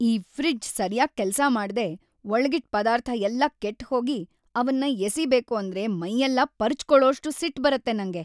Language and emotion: Kannada, angry